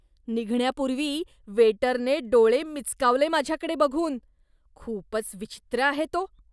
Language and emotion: Marathi, disgusted